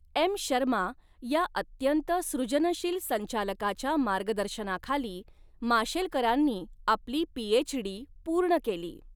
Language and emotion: Marathi, neutral